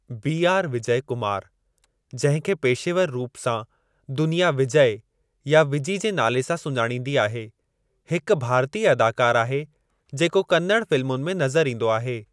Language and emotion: Sindhi, neutral